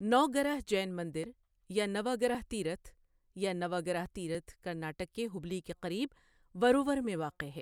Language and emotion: Urdu, neutral